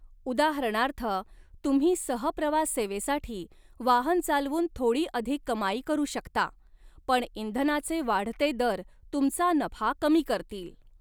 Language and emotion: Marathi, neutral